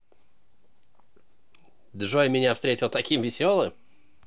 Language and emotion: Russian, positive